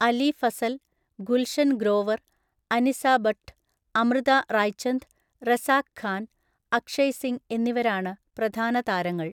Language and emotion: Malayalam, neutral